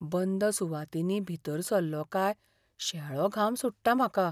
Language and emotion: Goan Konkani, fearful